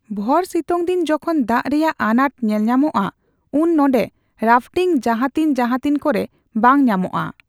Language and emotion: Santali, neutral